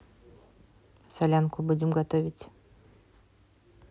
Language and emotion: Russian, neutral